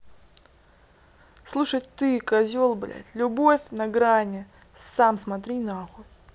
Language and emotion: Russian, angry